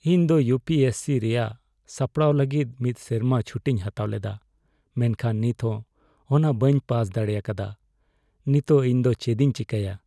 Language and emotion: Santali, sad